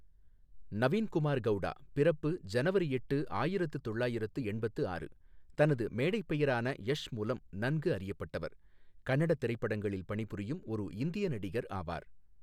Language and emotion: Tamil, neutral